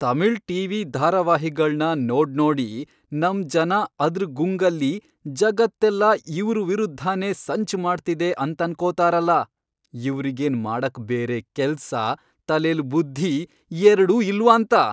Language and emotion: Kannada, angry